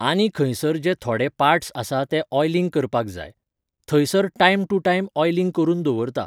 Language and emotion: Goan Konkani, neutral